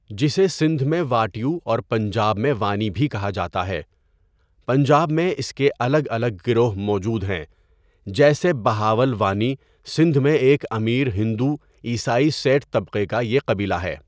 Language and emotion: Urdu, neutral